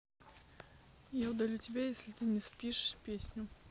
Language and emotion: Russian, neutral